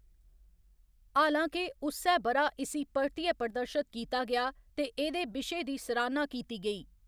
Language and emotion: Dogri, neutral